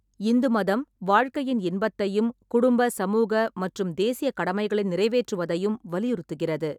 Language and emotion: Tamil, neutral